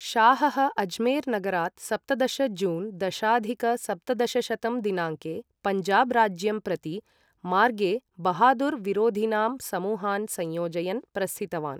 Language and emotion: Sanskrit, neutral